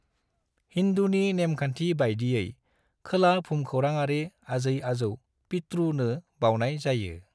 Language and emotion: Bodo, neutral